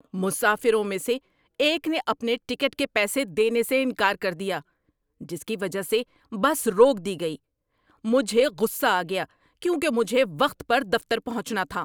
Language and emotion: Urdu, angry